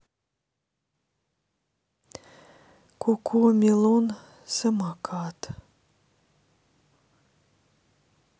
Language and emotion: Russian, sad